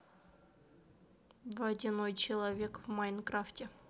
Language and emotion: Russian, neutral